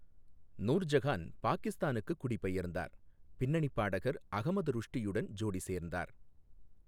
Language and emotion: Tamil, neutral